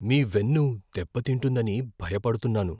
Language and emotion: Telugu, fearful